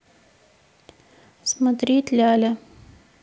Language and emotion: Russian, neutral